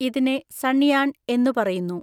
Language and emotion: Malayalam, neutral